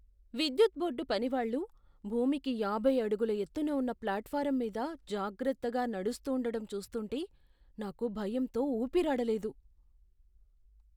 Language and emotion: Telugu, fearful